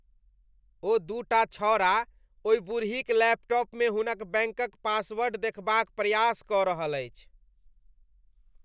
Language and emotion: Maithili, disgusted